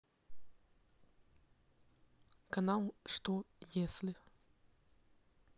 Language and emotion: Russian, neutral